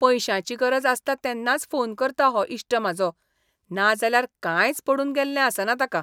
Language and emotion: Goan Konkani, disgusted